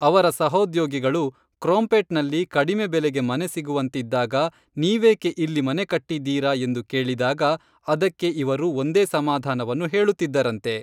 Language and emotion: Kannada, neutral